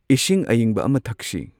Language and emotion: Manipuri, neutral